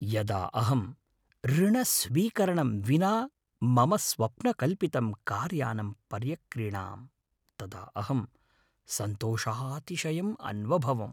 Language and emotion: Sanskrit, happy